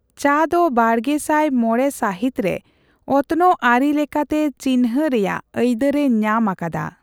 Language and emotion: Santali, neutral